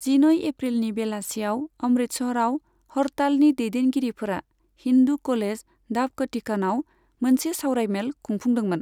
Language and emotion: Bodo, neutral